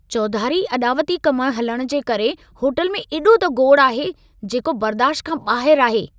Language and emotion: Sindhi, angry